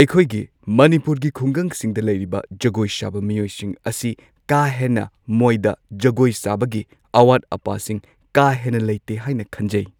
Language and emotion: Manipuri, neutral